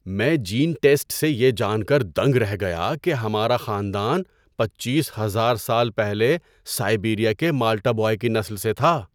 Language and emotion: Urdu, surprised